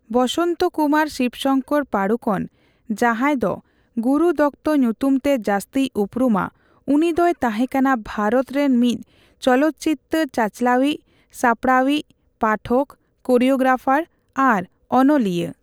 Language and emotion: Santali, neutral